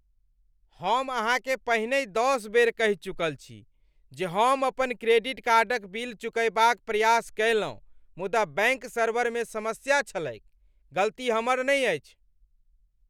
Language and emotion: Maithili, angry